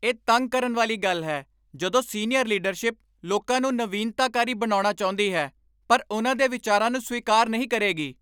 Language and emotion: Punjabi, angry